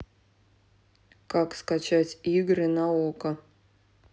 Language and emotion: Russian, neutral